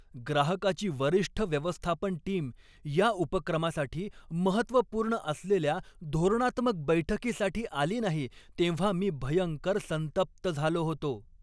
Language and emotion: Marathi, angry